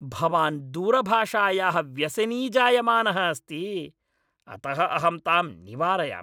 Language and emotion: Sanskrit, angry